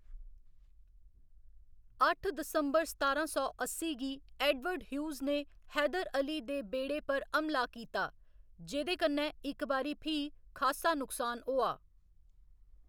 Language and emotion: Dogri, neutral